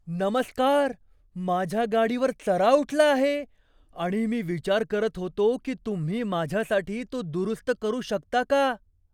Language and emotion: Marathi, surprised